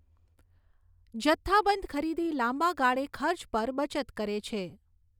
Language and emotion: Gujarati, neutral